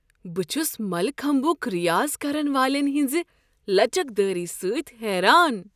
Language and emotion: Kashmiri, surprised